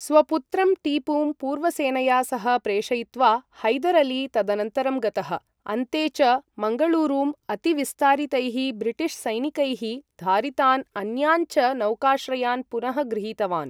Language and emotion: Sanskrit, neutral